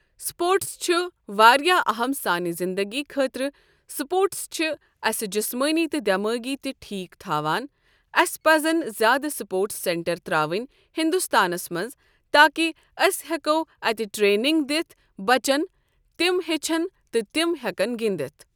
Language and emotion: Kashmiri, neutral